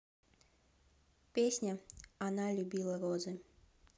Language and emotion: Russian, neutral